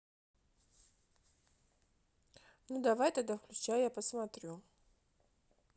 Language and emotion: Russian, neutral